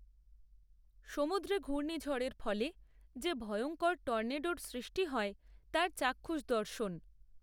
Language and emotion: Bengali, neutral